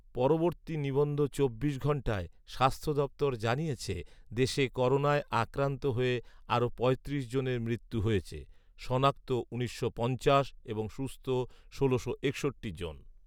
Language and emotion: Bengali, neutral